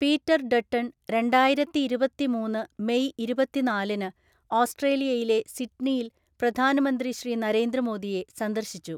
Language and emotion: Malayalam, neutral